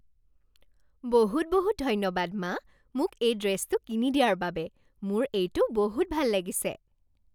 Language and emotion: Assamese, happy